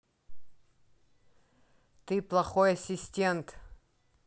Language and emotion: Russian, angry